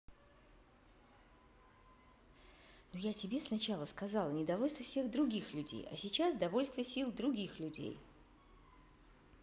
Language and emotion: Russian, angry